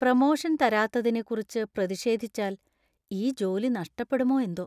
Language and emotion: Malayalam, fearful